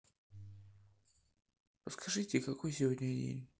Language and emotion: Russian, sad